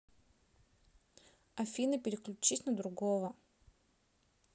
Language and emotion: Russian, neutral